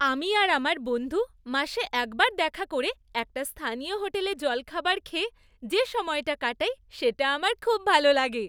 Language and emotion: Bengali, happy